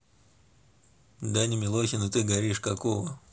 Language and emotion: Russian, neutral